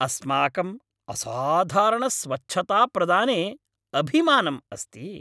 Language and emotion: Sanskrit, happy